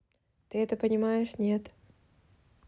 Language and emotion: Russian, neutral